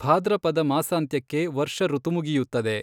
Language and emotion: Kannada, neutral